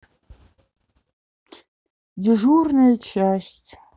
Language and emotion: Russian, neutral